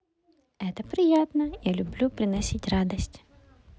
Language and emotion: Russian, positive